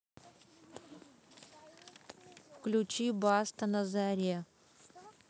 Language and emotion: Russian, neutral